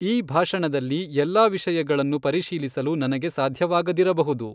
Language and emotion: Kannada, neutral